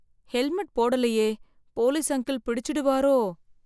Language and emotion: Tamil, fearful